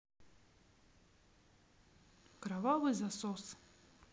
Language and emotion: Russian, neutral